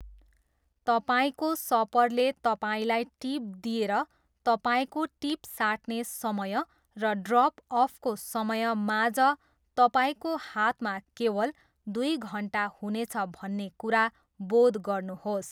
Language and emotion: Nepali, neutral